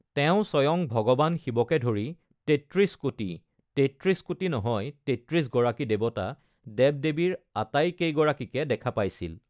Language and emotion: Assamese, neutral